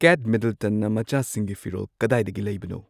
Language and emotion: Manipuri, neutral